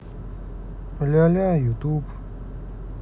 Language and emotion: Russian, neutral